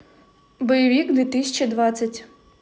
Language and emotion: Russian, neutral